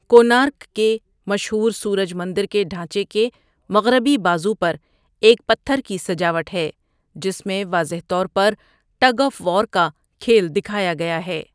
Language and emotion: Urdu, neutral